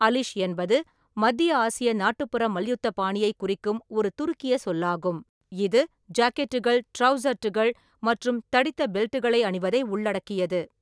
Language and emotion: Tamil, neutral